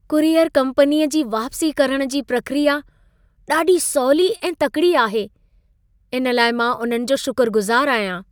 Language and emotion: Sindhi, happy